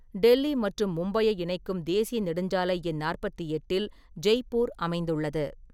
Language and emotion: Tamil, neutral